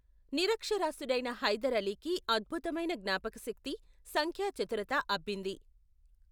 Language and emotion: Telugu, neutral